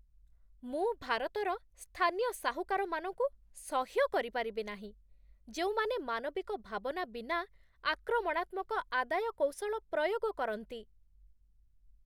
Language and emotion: Odia, disgusted